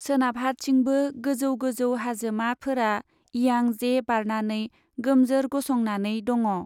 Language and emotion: Bodo, neutral